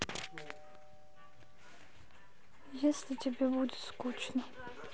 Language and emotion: Russian, sad